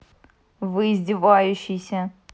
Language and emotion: Russian, angry